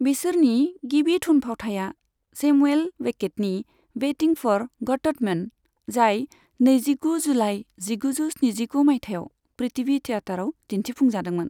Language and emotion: Bodo, neutral